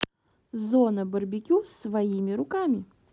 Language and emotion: Russian, neutral